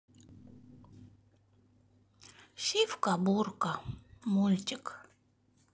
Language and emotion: Russian, sad